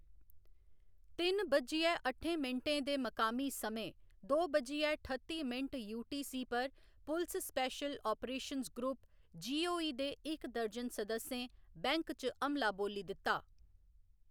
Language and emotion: Dogri, neutral